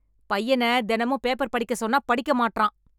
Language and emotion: Tamil, angry